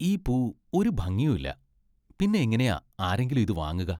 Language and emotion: Malayalam, disgusted